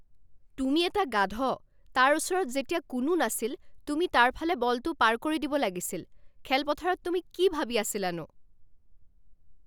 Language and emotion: Assamese, angry